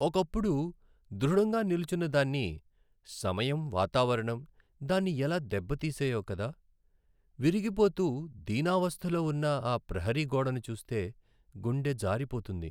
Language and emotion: Telugu, sad